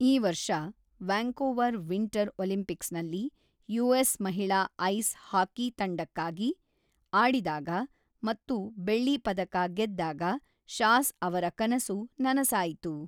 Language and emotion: Kannada, neutral